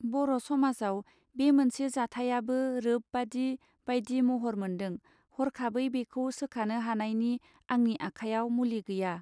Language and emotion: Bodo, neutral